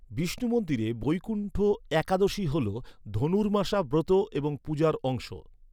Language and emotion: Bengali, neutral